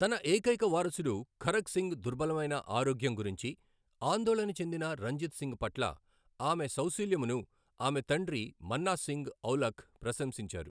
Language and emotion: Telugu, neutral